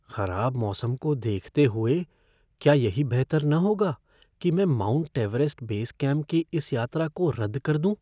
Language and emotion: Hindi, fearful